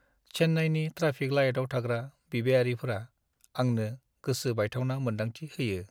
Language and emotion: Bodo, sad